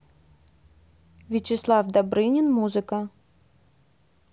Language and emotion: Russian, neutral